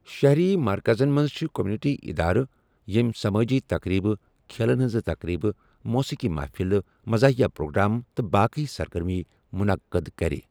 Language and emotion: Kashmiri, neutral